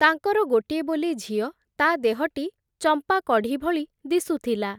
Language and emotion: Odia, neutral